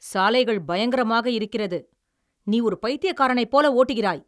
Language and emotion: Tamil, angry